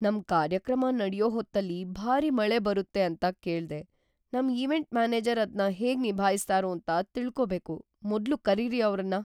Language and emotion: Kannada, fearful